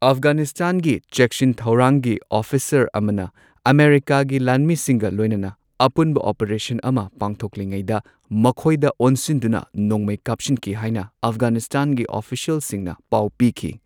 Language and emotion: Manipuri, neutral